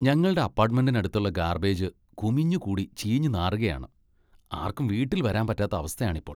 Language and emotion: Malayalam, disgusted